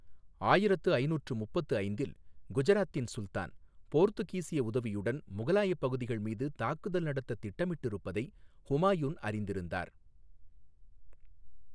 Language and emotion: Tamil, neutral